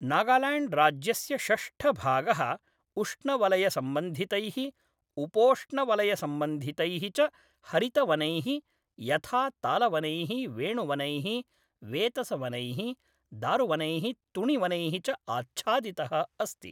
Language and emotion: Sanskrit, neutral